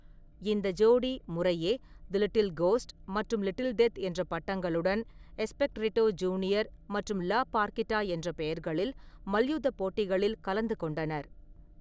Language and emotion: Tamil, neutral